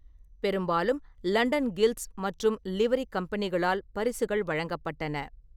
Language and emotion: Tamil, neutral